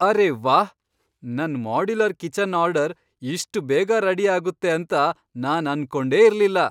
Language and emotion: Kannada, surprised